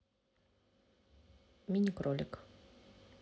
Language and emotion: Russian, neutral